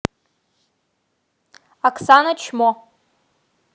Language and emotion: Russian, angry